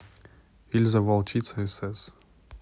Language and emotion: Russian, neutral